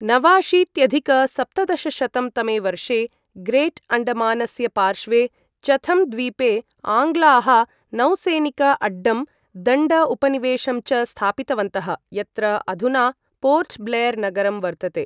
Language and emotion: Sanskrit, neutral